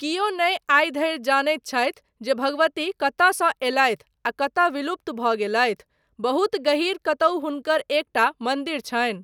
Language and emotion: Maithili, neutral